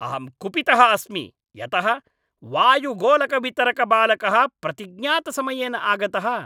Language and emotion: Sanskrit, angry